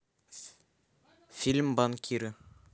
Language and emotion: Russian, neutral